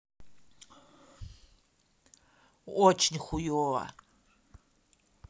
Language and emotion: Russian, sad